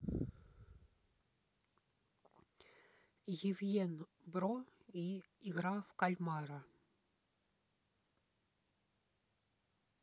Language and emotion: Russian, neutral